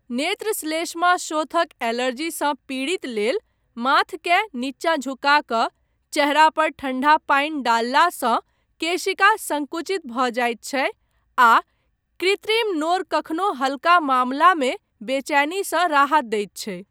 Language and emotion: Maithili, neutral